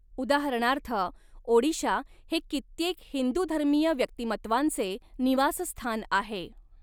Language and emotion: Marathi, neutral